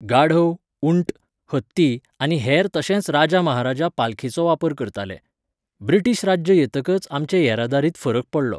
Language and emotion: Goan Konkani, neutral